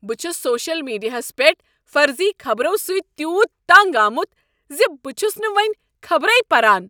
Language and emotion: Kashmiri, angry